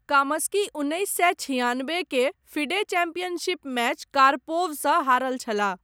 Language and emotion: Maithili, neutral